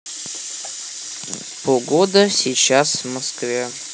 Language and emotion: Russian, neutral